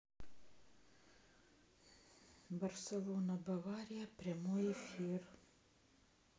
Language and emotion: Russian, sad